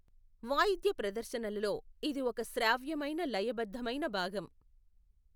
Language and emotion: Telugu, neutral